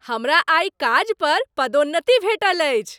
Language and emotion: Maithili, happy